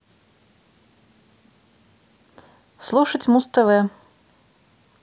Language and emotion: Russian, neutral